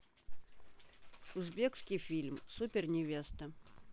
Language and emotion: Russian, neutral